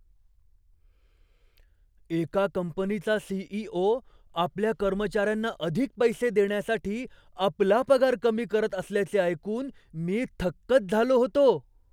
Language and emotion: Marathi, surprised